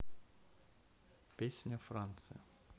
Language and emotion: Russian, neutral